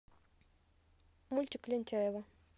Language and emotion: Russian, neutral